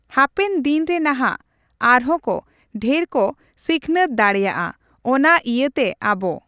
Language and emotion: Santali, neutral